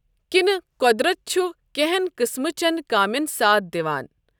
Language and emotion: Kashmiri, neutral